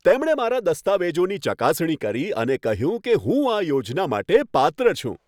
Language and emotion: Gujarati, happy